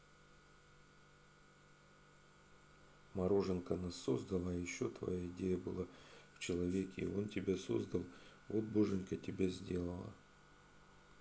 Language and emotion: Russian, neutral